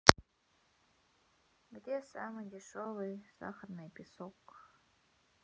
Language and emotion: Russian, neutral